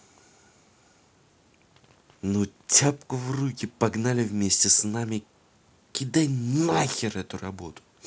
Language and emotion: Russian, angry